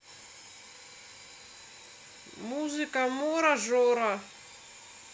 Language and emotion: Russian, neutral